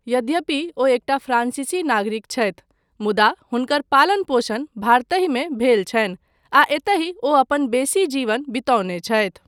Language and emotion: Maithili, neutral